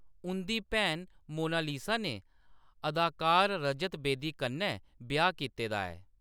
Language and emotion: Dogri, neutral